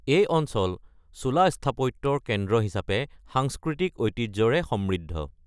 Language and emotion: Assamese, neutral